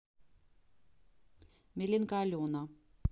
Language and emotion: Russian, neutral